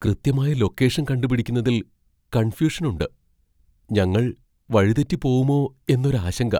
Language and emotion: Malayalam, fearful